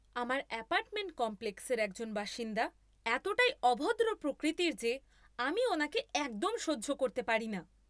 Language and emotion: Bengali, angry